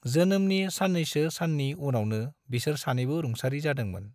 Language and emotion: Bodo, neutral